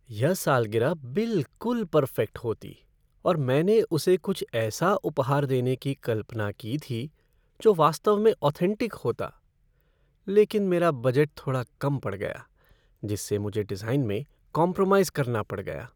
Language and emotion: Hindi, sad